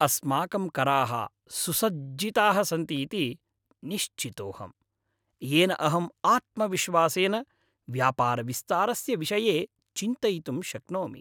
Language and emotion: Sanskrit, happy